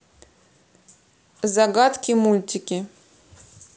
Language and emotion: Russian, neutral